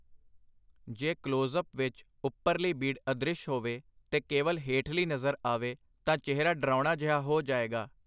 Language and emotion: Punjabi, neutral